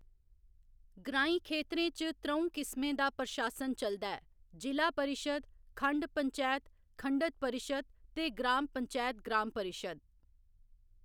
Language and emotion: Dogri, neutral